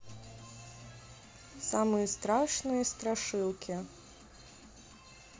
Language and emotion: Russian, neutral